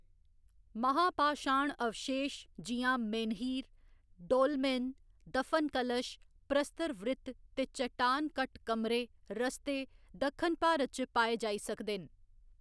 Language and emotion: Dogri, neutral